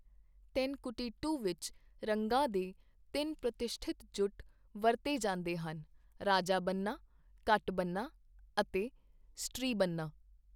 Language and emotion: Punjabi, neutral